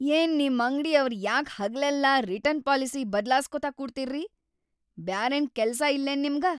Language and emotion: Kannada, angry